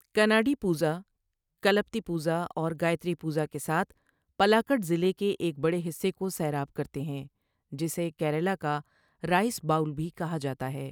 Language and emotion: Urdu, neutral